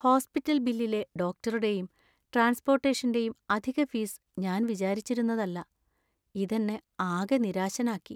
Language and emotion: Malayalam, sad